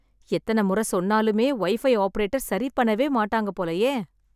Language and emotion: Tamil, sad